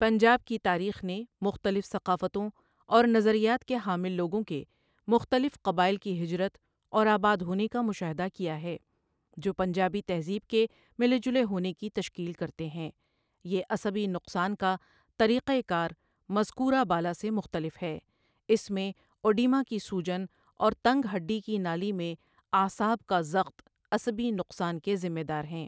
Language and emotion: Urdu, neutral